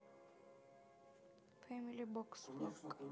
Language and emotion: Russian, neutral